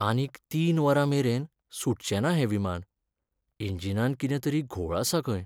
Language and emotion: Goan Konkani, sad